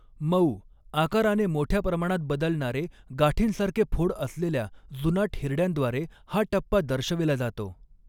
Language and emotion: Marathi, neutral